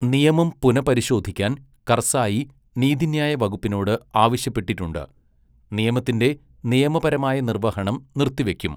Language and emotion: Malayalam, neutral